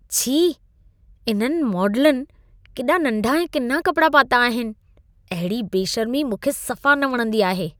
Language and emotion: Sindhi, disgusted